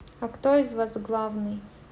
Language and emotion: Russian, neutral